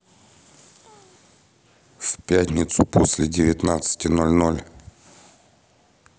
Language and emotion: Russian, neutral